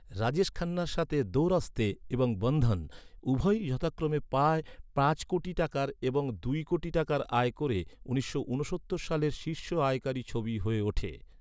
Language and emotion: Bengali, neutral